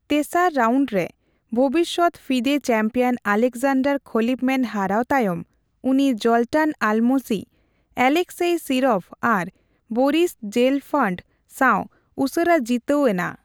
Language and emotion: Santali, neutral